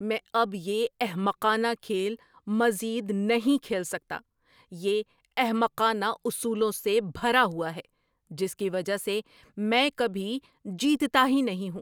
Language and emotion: Urdu, angry